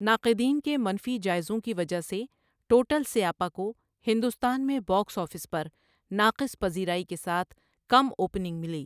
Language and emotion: Urdu, neutral